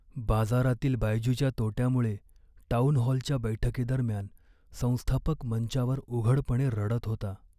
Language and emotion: Marathi, sad